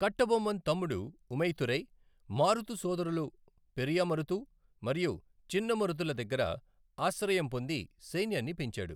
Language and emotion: Telugu, neutral